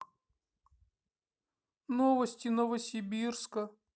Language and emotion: Russian, sad